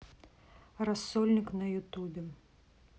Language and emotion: Russian, neutral